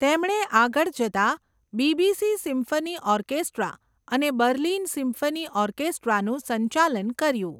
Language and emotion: Gujarati, neutral